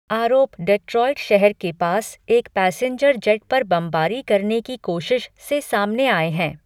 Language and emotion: Hindi, neutral